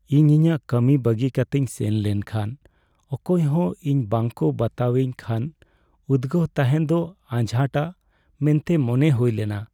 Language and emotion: Santali, sad